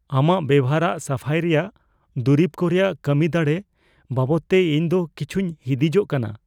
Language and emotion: Santali, fearful